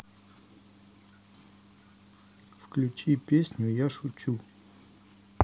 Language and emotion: Russian, neutral